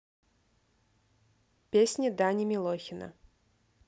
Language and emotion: Russian, neutral